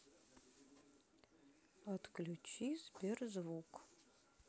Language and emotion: Russian, neutral